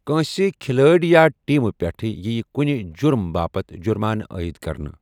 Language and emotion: Kashmiri, neutral